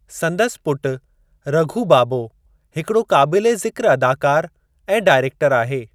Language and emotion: Sindhi, neutral